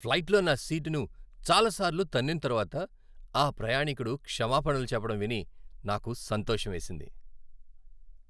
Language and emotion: Telugu, happy